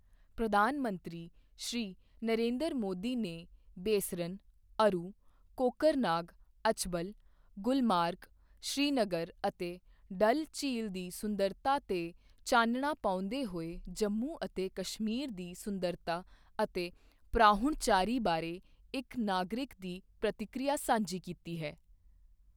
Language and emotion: Punjabi, neutral